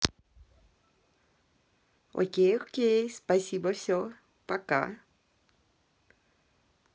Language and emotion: Russian, positive